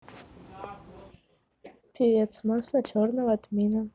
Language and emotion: Russian, neutral